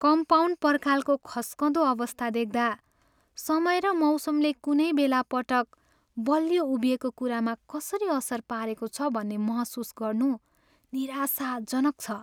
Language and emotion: Nepali, sad